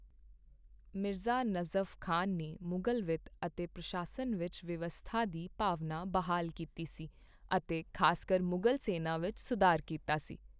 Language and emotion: Punjabi, neutral